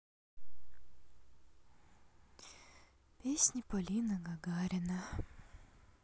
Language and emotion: Russian, sad